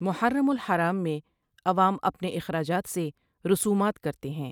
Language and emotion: Urdu, neutral